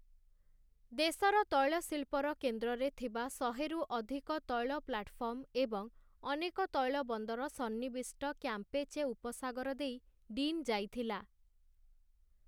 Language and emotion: Odia, neutral